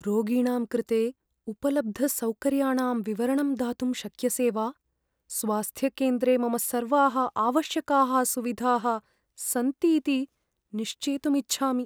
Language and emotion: Sanskrit, fearful